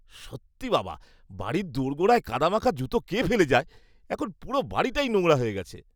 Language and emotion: Bengali, disgusted